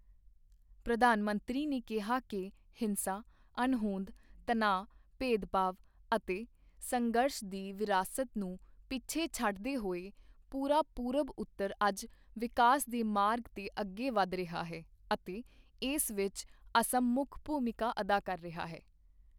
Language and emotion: Punjabi, neutral